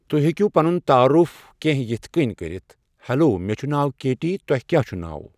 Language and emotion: Kashmiri, neutral